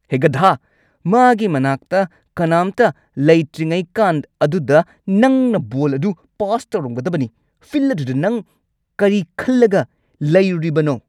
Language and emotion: Manipuri, angry